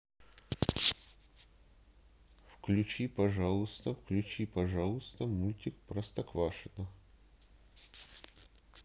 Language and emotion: Russian, neutral